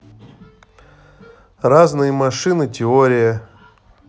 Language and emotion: Russian, neutral